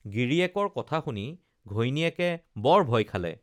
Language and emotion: Assamese, neutral